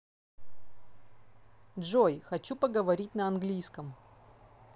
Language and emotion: Russian, neutral